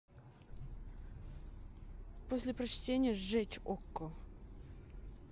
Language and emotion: Russian, neutral